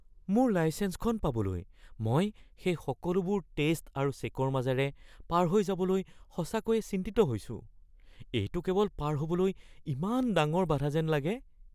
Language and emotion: Assamese, fearful